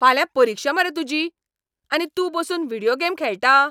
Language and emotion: Goan Konkani, angry